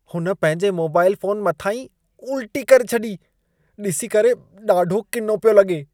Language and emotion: Sindhi, disgusted